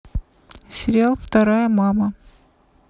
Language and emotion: Russian, neutral